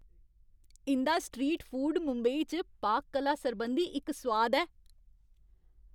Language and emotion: Dogri, happy